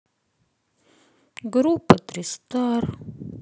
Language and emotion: Russian, sad